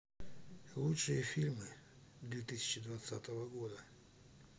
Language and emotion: Russian, sad